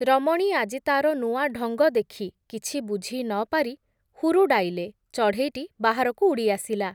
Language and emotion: Odia, neutral